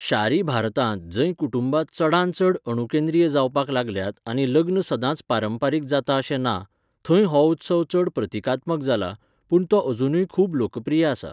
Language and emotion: Goan Konkani, neutral